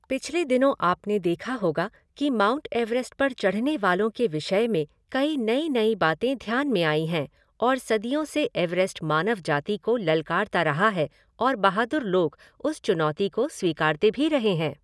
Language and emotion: Hindi, neutral